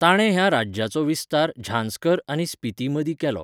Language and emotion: Goan Konkani, neutral